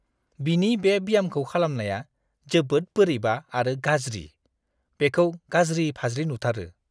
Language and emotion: Bodo, disgusted